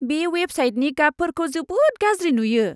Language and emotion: Bodo, disgusted